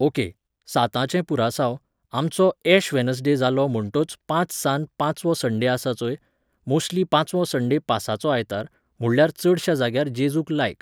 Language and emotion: Goan Konkani, neutral